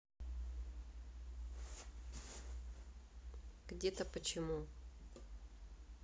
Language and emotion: Russian, neutral